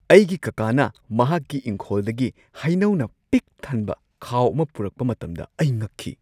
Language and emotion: Manipuri, surprised